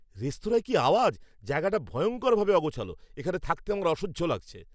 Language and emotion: Bengali, angry